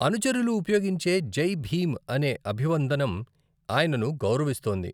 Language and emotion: Telugu, neutral